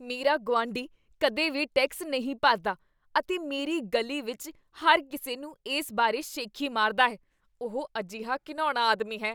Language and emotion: Punjabi, disgusted